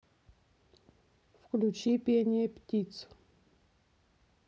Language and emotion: Russian, neutral